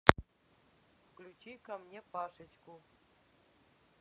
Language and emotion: Russian, neutral